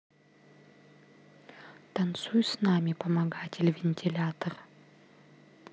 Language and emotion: Russian, neutral